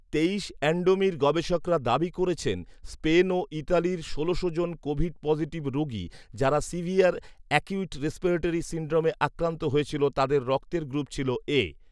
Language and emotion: Bengali, neutral